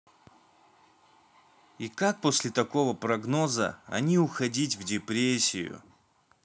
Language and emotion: Russian, neutral